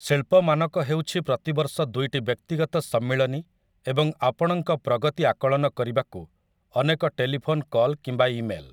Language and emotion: Odia, neutral